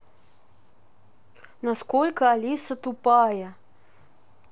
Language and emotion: Russian, neutral